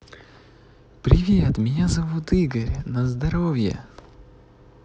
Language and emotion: Russian, positive